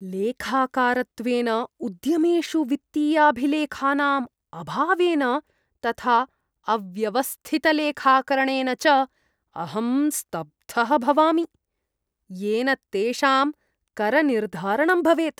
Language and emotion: Sanskrit, disgusted